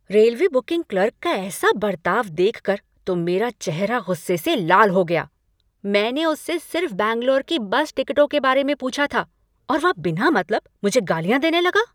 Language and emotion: Hindi, angry